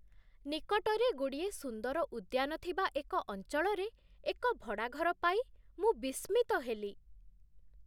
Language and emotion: Odia, surprised